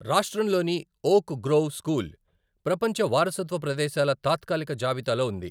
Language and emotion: Telugu, neutral